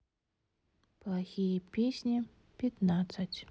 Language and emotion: Russian, sad